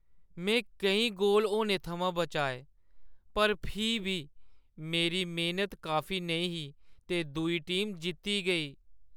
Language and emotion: Dogri, sad